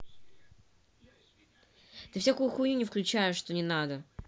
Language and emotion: Russian, angry